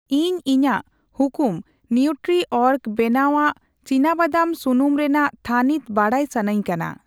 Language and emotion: Santali, neutral